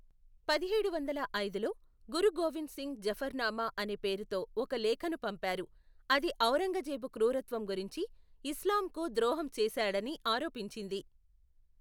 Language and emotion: Telugu, neutral